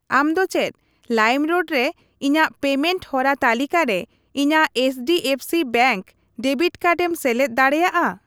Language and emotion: Santali, neutral